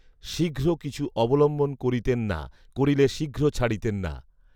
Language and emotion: Bengali, neutral